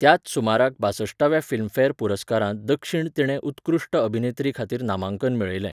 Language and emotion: Goan Konkani, neutral